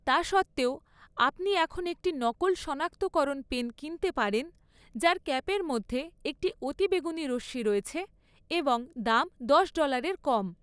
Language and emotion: Bengali, neutral